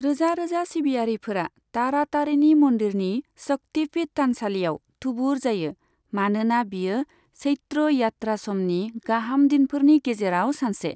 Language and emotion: Bodo, neutral